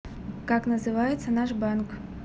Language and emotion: Russian, neutral